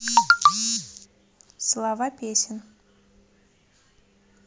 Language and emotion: Russian, neutral